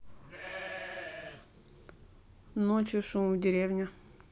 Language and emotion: Russian, neutral